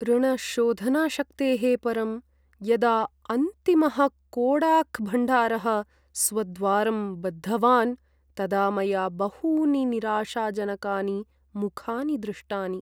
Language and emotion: Sanskrit, sad